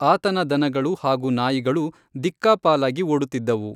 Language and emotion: Kannada, neutral